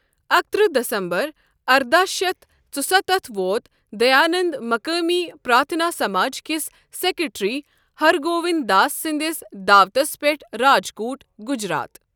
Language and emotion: Kashmiri, neutral